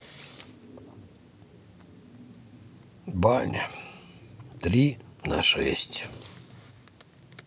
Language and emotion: Russian, sad